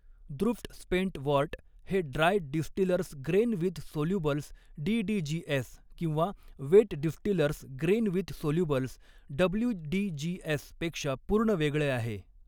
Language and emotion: Marathi, neutral